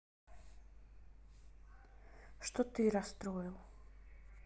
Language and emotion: Russian, sad